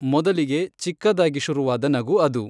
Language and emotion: Kannada, neutral